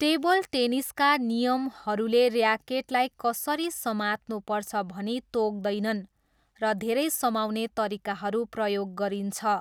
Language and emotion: Nepali, neutral